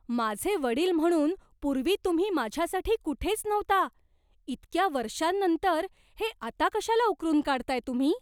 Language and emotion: Marathi, surprised